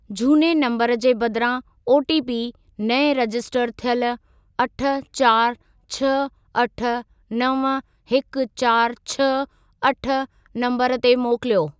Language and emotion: Sindhi, neutral